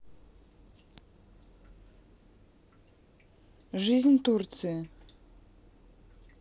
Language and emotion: Russian, neutral